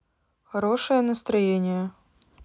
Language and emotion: Russian, neutral